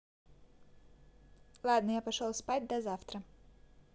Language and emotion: Russian, neutral